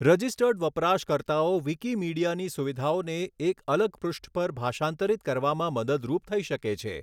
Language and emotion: Gujarati, neutral